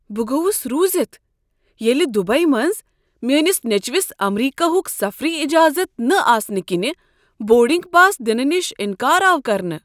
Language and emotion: Kashmiri, surprised